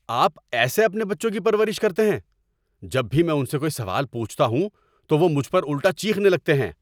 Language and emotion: Urdu, angry